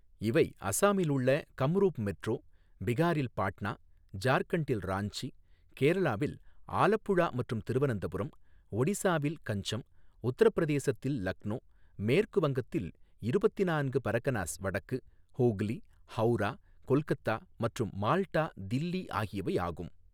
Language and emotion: Tamil, neutral